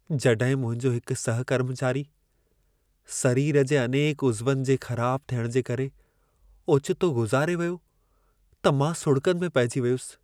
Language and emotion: Sindhi, sad